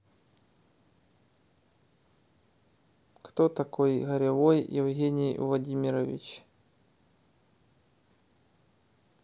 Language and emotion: Russian, neutral